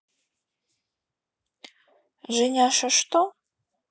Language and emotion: Russian, neutral